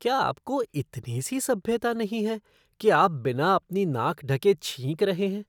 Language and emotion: Hindi, disgusted